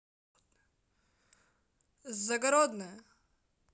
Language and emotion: Russian, positive